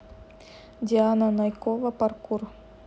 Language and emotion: Russian, neutral